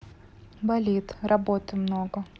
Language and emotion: Russian, neutral